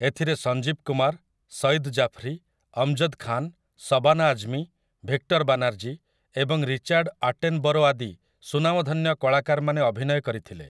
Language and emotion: Odia, neutral